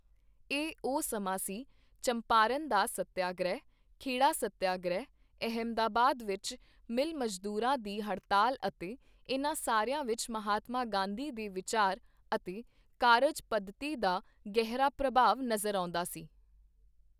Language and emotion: Punjabi, neutral